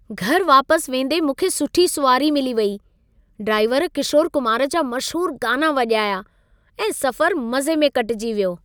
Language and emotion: Sindhi, happy